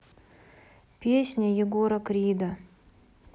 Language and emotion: Russian, sad